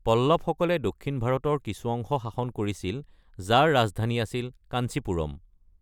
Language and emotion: Assamese, neutral